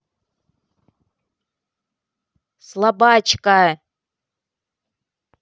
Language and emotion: Russian, angry